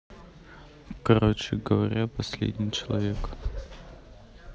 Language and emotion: Russian, neutral